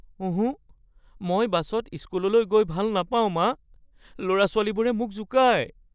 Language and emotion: Assamese, fearful